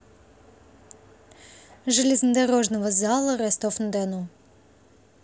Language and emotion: Russian, neutral